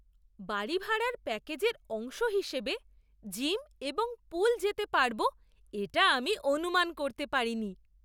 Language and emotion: Bengali, surprised